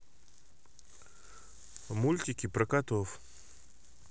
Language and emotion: Russian, neutral